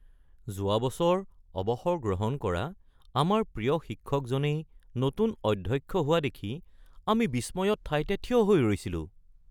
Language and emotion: Assamese, surprised